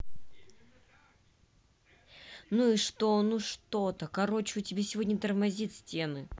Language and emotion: Russian, angry